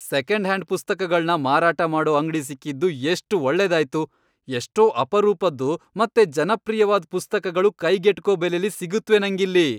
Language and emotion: Kannada, happy